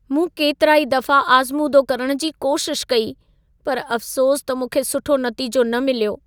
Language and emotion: Sindhi, sad